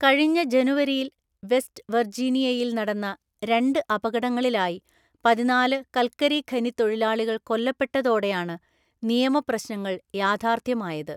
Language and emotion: Malayalam, neutral